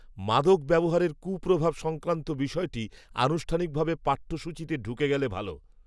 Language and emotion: Bengali, neutral